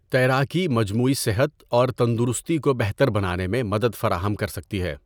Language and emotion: Urdu, neutral